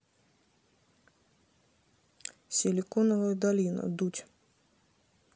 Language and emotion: Russian, neutral